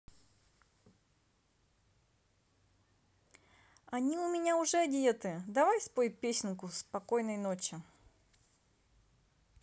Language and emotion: Russian, positive